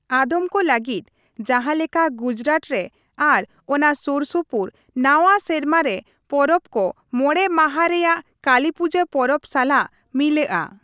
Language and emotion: Santali, neutral